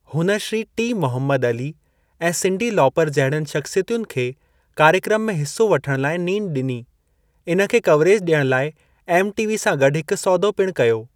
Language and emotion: Sindhi, neutral